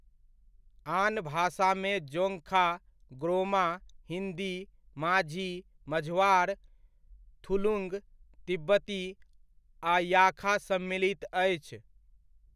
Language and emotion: Maithili, neutral